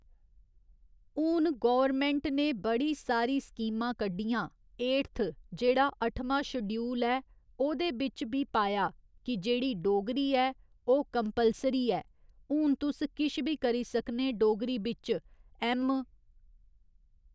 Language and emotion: Dogri, neutral